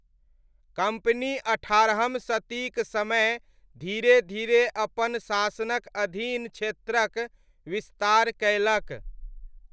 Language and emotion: Maithili, neutral